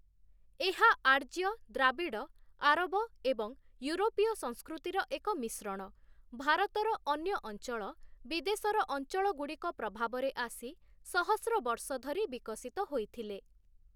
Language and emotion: Odia, neutral